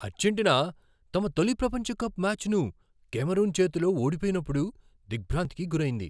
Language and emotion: Telugu, surprised